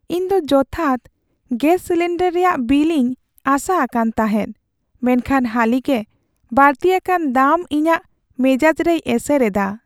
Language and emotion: Santali, sad